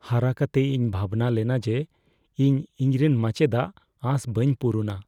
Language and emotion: Santali, fearful